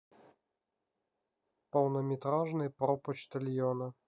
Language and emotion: Russian, neutral